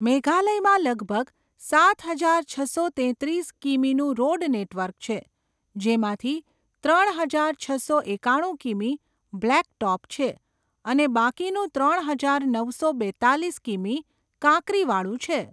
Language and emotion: Gujarati, neutral